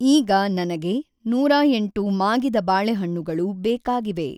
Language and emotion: Kannada, neutral